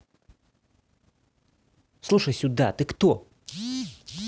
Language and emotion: Russian, angry